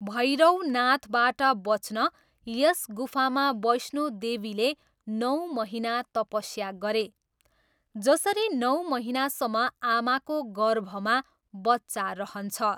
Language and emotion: Nepali, neutral